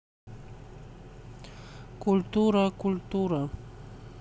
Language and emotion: Russian, neutral